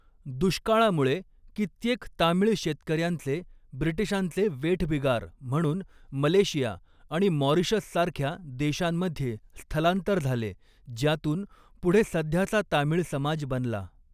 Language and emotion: Marathi, neutral